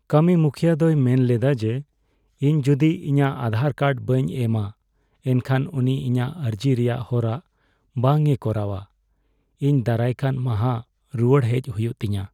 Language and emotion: Santali, sad